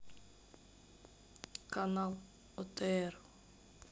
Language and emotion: Russian, neutral